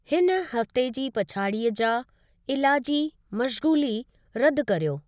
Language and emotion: Sindhi, neutral